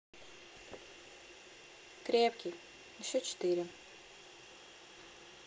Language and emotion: Russian, neutral